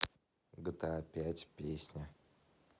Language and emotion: Russian, neutral